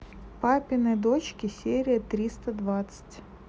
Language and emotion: Russian, neutral